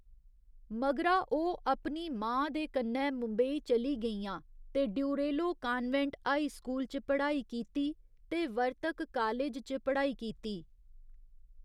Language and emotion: Dogri, neutral